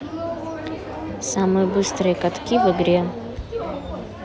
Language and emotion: Russian, neutral